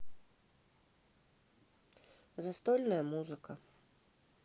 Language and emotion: Russian, neutral